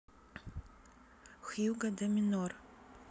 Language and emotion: Russian, neutral